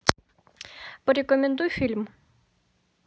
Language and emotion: Russian, neutral